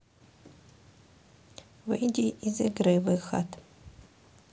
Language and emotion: Russian, neutral